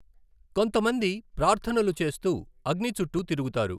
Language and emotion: Telugu, neutral